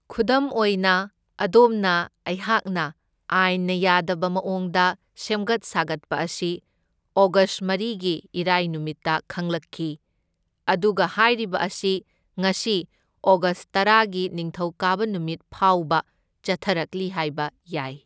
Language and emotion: Manipuri, neutral